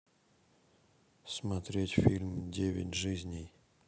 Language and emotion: Russian, neutral